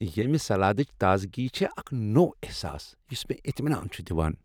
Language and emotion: Kashmiri, happy